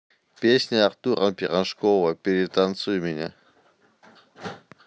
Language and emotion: Russian, neutral